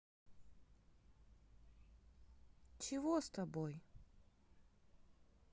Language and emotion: Russian, neutral